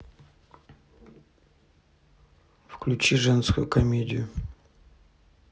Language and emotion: Russian, neutral